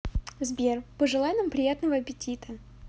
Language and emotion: Russian, positive